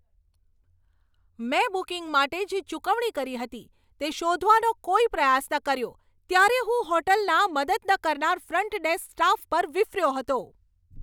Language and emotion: Gujarati, angry